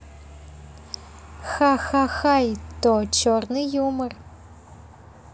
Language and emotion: Russian, positive